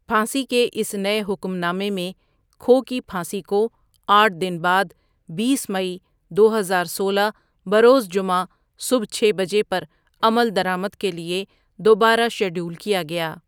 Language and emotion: Urdu, neutral